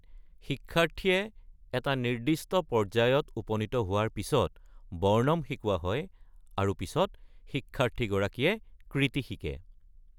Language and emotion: Assamese, neutral